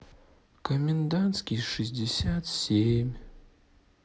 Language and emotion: Russian, sad